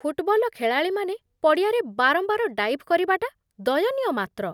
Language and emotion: Odia, disgusted